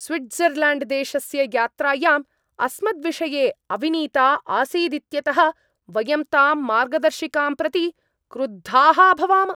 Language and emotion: Sanskrit, angry